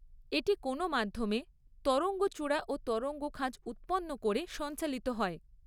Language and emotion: Bengali, neutral